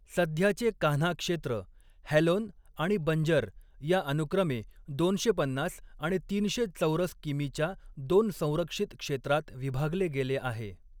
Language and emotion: Marathi, neutral